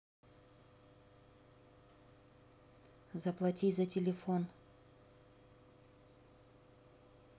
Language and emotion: Russian, neutral